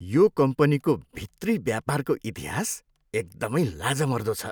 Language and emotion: Nepali, disgusted